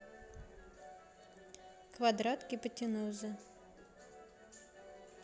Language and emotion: Russian, neutral